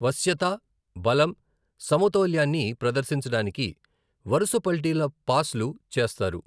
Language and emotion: Telugu, neutral